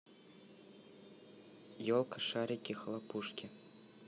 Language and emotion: Russian, neutral